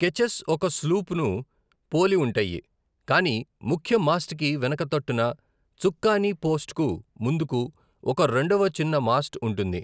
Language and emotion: Telugu, neutral